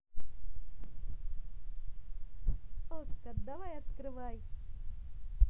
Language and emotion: Russian, positive